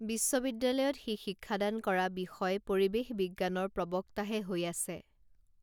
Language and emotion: Assamese, neutral